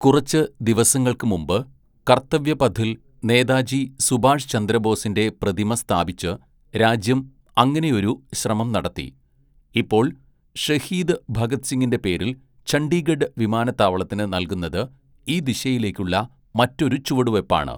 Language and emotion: Malayalam, neutral